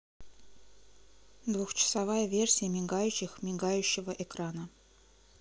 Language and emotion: Russian, neutral